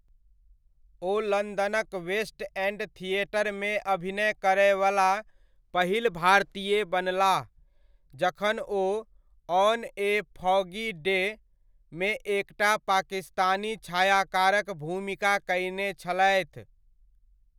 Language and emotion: Maithili, neutral